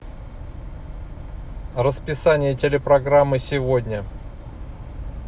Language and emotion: Russian, neutral